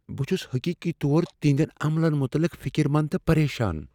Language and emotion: Kashmiri, fearful